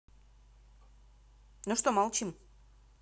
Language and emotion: Russian, angry